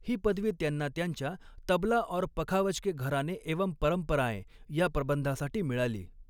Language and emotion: Marathi, neutral